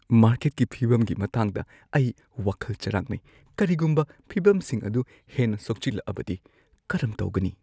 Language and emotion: Manipuri, fearful